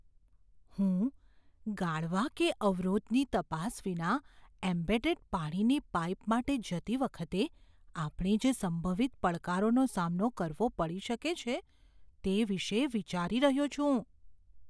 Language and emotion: Gujarati, fearful